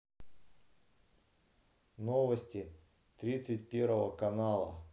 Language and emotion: Russian, neutral